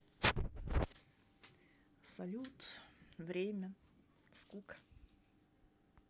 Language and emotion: Russian, sad